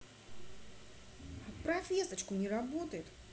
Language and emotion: Russian, neutral